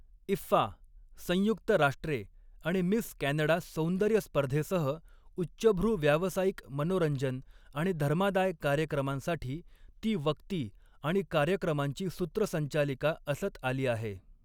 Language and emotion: Marathi, neutral